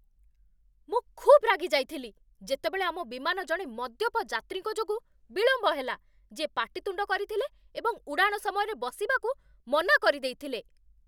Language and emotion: Odia, angry